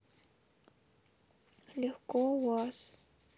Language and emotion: Russian, sad